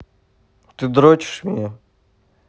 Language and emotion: Russian, neutral